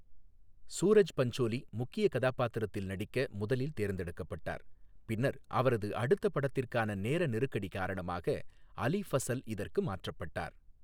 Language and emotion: Tamil, neutral